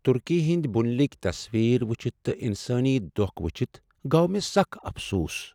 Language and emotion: Kashmiri, sad